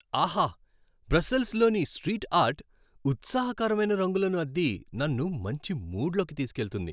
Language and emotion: Telugu, happy